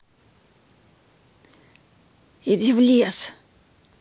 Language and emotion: Russian, angry